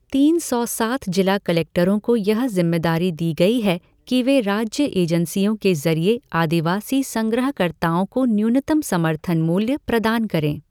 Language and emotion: Hindi, neutral